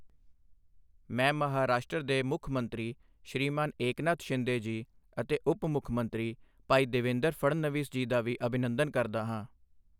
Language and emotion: Punjabi, neutral